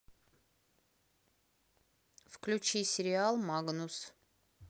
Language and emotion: Russian, neutral